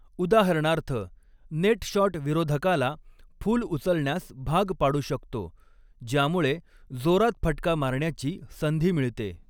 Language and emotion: Marathi, neutral